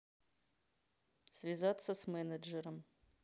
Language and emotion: Russian, neutral